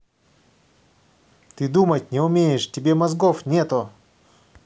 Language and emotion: Russian, angry